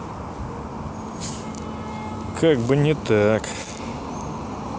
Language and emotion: Russian, neutral